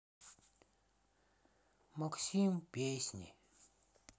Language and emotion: Russian, sad